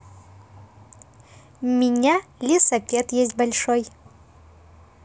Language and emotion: Russian, positive